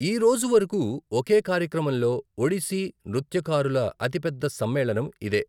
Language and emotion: Telugu, neutral